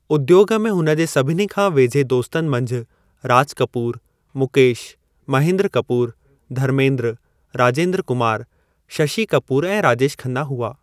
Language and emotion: Sindhi, neutral